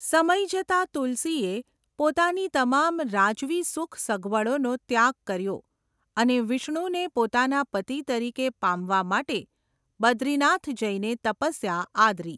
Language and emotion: Gujarati, neutral